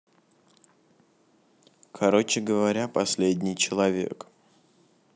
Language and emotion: Russian, neutral